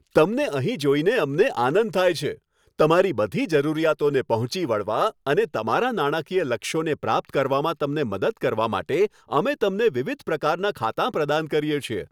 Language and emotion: Gujarati, happy